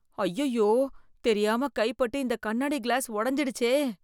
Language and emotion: Tamil, fearful